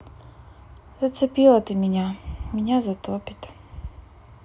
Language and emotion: Russian, sad